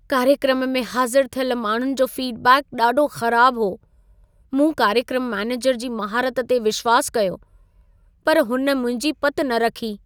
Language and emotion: Sindhi, sad